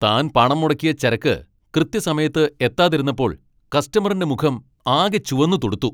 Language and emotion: Malayalam, angry